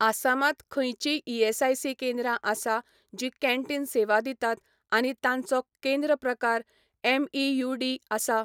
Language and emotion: Goan Konkani, neutral